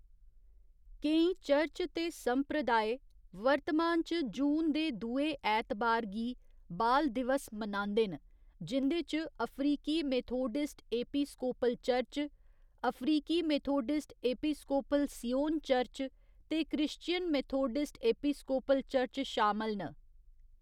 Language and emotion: Dogri, neutral